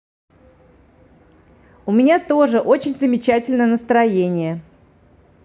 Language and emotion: Russian, positive